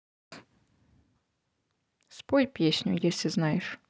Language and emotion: Russian, neutral